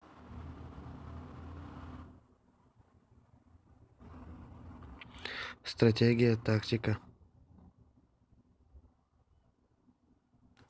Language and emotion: Russian, neutral